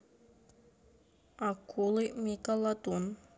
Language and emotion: Russian, neutral